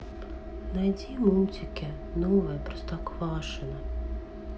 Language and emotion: Russian, sad